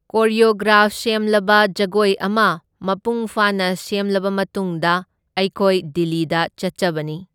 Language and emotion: Manipuri, neutral